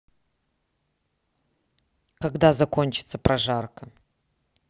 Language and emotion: Russian, neutral